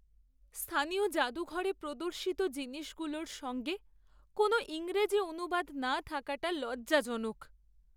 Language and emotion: Bengali, sad